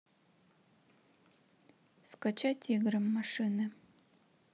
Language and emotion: Russian, neutral